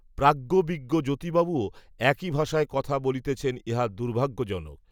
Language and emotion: Bengali, neutral